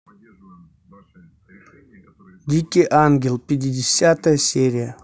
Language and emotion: Russian, neutral